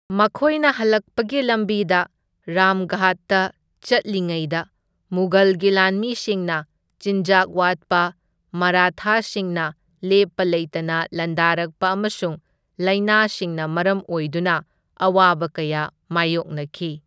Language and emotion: Manipuri, neutral